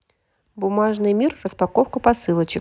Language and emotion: Russian, positive